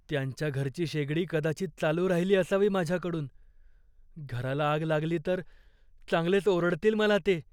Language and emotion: Marathi, fearful